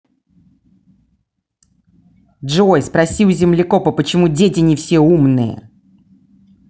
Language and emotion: Russian, angry